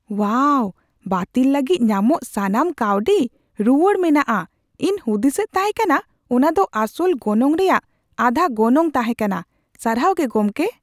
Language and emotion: Santali, surprised